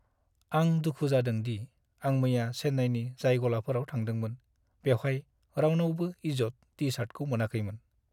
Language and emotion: Bodo, sad